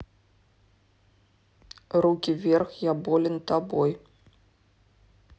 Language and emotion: Russian, neutral